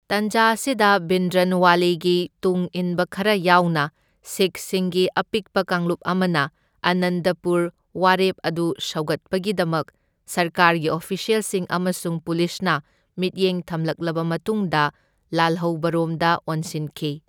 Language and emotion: Manipuri, neutral